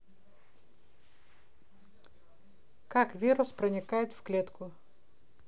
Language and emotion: Russian, neutral